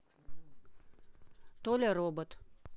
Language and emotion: Russian, neutral